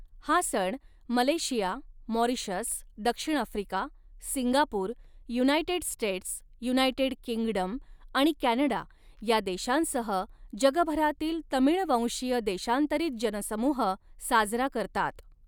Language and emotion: Marathi, neutral